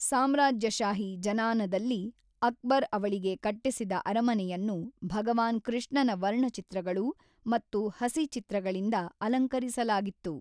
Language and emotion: Kannada, neutral